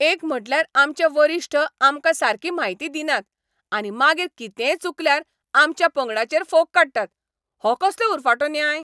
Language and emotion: Goan Konkani, angry